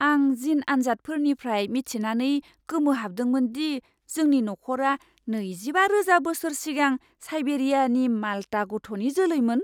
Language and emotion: Bodo, surprised